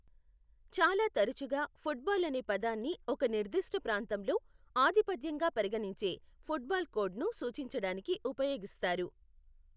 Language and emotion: Telugu, neutral